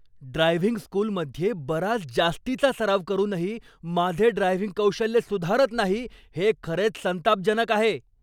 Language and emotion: Marathi, angry